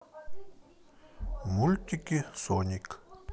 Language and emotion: Russian, neutral